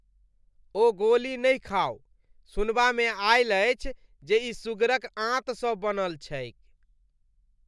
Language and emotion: Maithili, disgusted